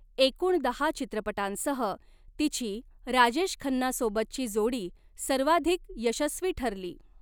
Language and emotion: Marathi, neutral